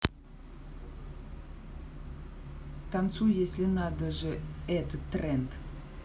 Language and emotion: Russian, neutral